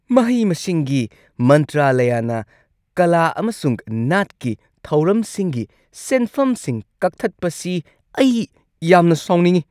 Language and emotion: Manipuri, angry